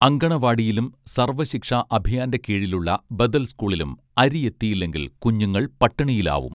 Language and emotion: Malayalam, neutral